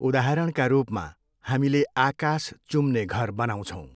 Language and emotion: Nepali, neutral